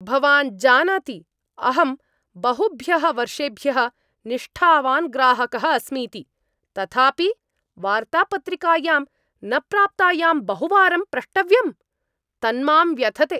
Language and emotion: Sanskrit, angry